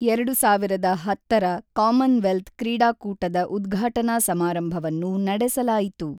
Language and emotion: Kannada, neutral